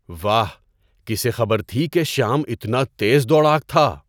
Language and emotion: Urdu, surprised